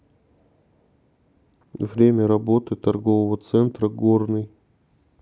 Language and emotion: Russian, neutral